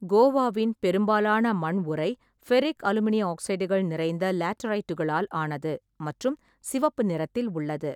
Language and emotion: Tamil, neutral